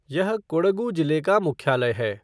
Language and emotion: Hindi, neutral